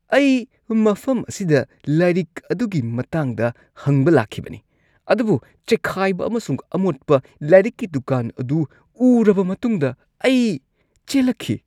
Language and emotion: Manipuri, disgusted